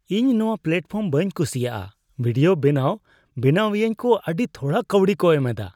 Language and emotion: Santali, disgusted